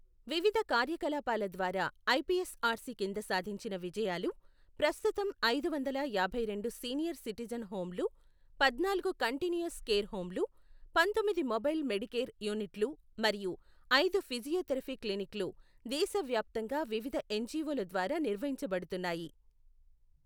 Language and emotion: Telugu, neutral